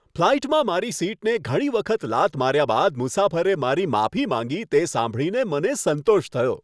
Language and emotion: Gujarati, happy